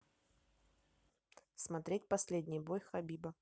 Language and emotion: Russian, neutral